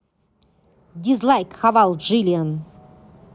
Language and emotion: Russian, angry